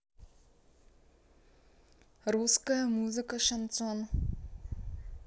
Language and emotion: Russian, neutral